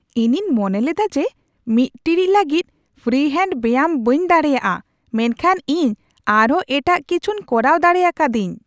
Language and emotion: Santali, surprised